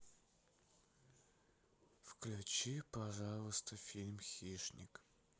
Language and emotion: Russian, sad